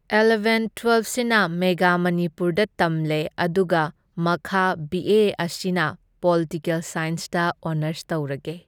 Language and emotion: Manipuri, neutral